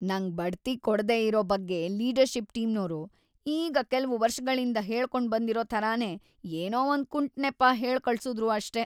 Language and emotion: Kannada, disgusted